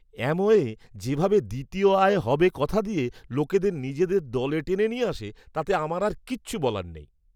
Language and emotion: Bengali, disgusted